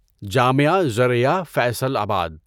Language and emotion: Urdu, neutral